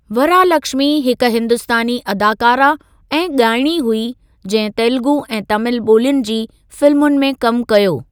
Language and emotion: Sindhi, neutral